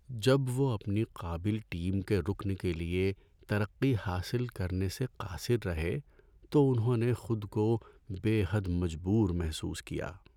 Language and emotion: Urdu, sad